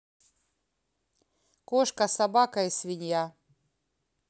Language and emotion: Russian, neutral